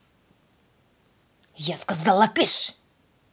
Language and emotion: Russian, angry